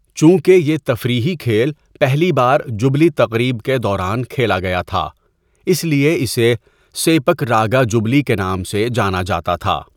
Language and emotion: Urdu, neutral